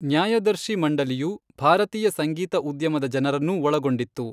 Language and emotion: Kannada, neutral